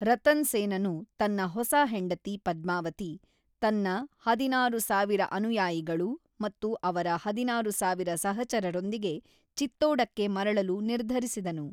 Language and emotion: Kannada, neutral